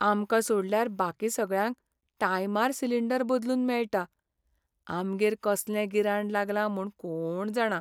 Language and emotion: Goan Konkani, sad